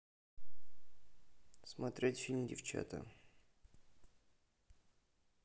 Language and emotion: Russian, neutral